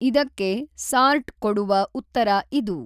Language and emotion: Kannada, neutral